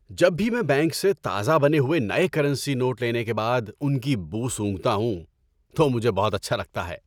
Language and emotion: Urdu, happy